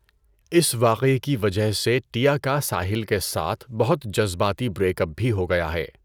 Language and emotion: Urdu, neutral